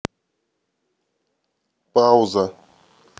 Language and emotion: Russian, neutral